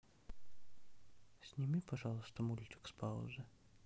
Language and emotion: Russian, sad